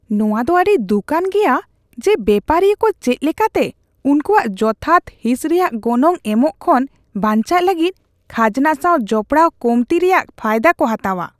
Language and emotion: Santali, disgusted